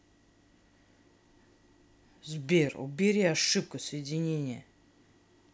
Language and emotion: Russian, angry